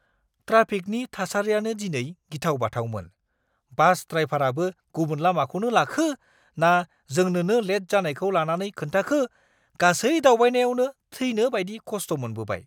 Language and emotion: Bodo, angry